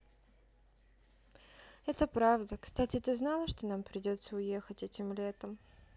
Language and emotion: Russian, sad